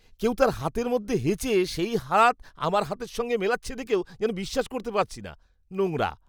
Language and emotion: Bengali, disgusted